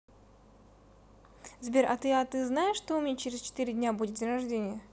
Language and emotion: Russian, neutral